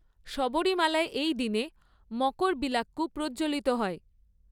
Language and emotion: Bengali, neutral